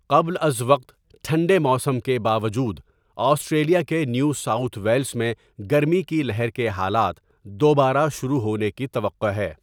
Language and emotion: Urdu, neutral